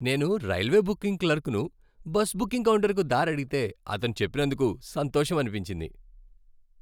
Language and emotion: Telugu, happy